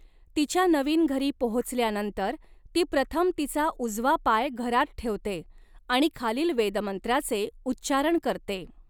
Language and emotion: Marathi, neutral